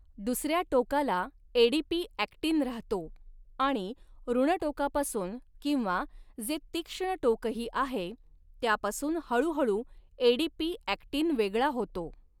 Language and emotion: Marathi, neutral